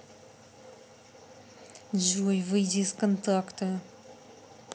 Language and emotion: Russian, angry